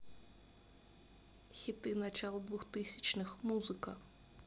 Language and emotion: Russian, neutral